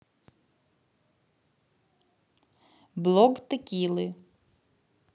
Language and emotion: Russian, neutral